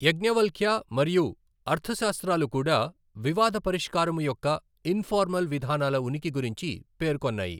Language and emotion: Telugu, neutral